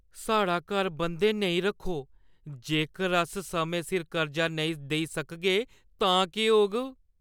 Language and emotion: Dogri, fearful